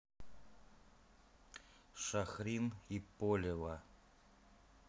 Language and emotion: Russian, neutral